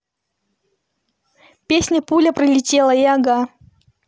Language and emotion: Russian, neutral